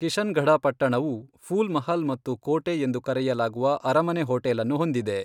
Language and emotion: Kannada, neutral